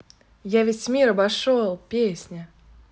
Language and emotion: Russian, positive